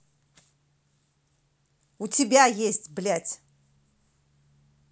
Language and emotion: Russian, angry